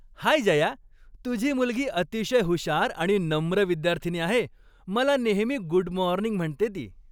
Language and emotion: Marathi, happy